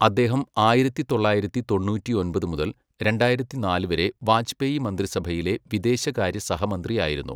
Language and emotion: Malayalam, neutral